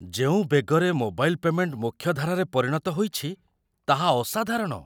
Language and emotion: Odia, surprised